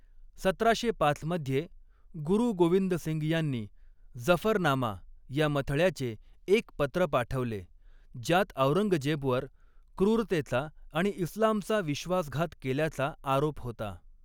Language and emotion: Marathi, neutral